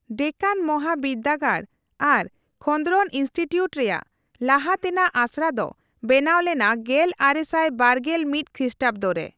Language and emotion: Santali, neutral